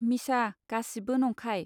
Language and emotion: Bodo, neutral